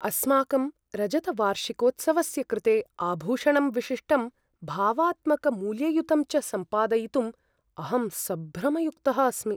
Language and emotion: Sanskrit, fearful